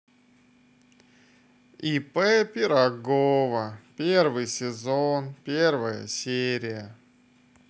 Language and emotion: Russian, neutral